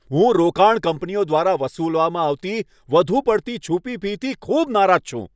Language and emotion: Gujarati, angry